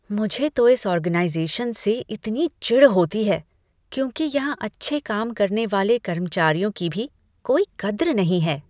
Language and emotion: Hindi, disgusted